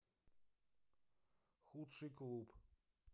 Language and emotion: Russian, neutral